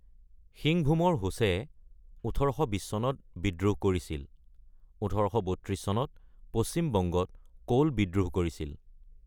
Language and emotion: Assamese, neutral